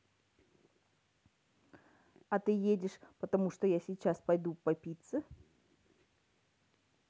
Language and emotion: Russian, neutral